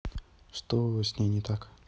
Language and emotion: Russian, neutral